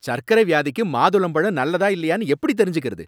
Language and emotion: Tamil, angry